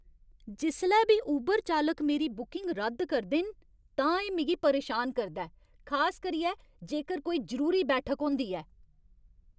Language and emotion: Dogri, angry